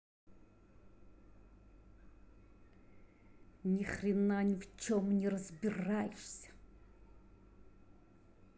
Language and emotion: Russian, angry